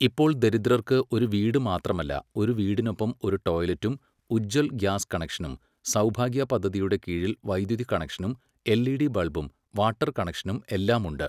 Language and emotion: Malayalam, neutral